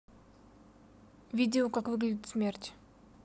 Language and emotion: Russian, neutral